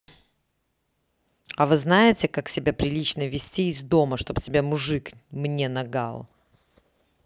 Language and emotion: Russian, angry